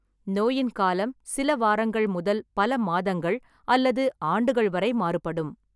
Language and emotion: Tamil, neutral